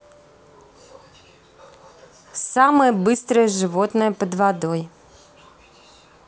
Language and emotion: Russian, neutral